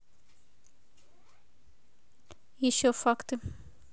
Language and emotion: Russian, neutral